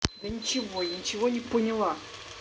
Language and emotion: Russian, angry